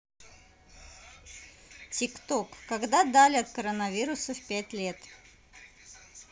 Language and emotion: Russian, neutral